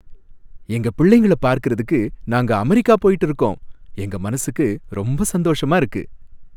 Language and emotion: Tamil, happy